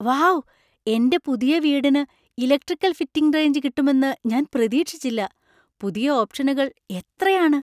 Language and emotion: Malayalam, surprised